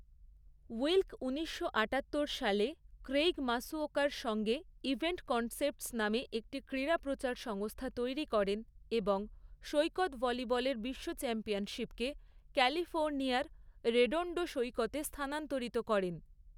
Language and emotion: Bengali, neutral